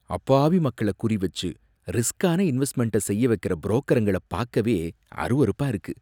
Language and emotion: Tamil, disgusted